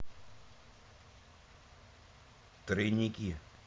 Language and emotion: Russian, neutral